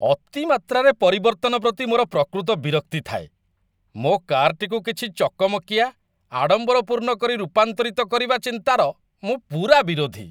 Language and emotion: Odia, disgusted